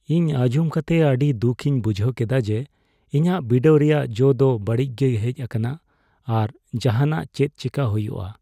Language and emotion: Santali, sad